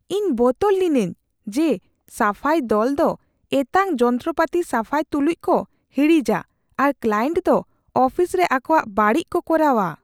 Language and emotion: Santali, fearful